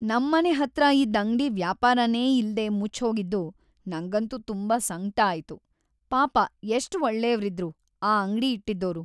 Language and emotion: Kannada, sad